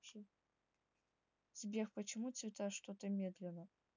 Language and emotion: Russian, neutral